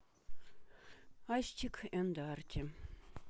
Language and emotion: Russian, sad